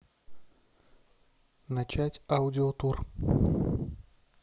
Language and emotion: Russian, neutral